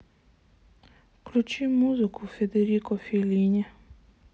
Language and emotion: Russian, sad